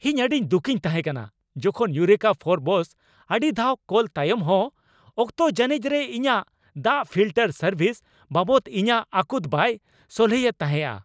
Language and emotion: Santali, angry